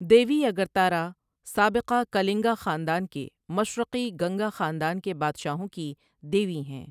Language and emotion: Urdu, neutral